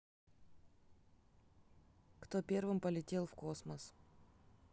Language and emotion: Russian, neutral